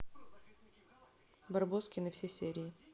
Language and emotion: Russian, neutral